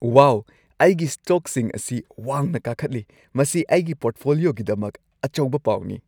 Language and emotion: Manipuri, happy